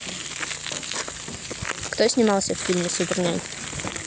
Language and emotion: Russian, neutral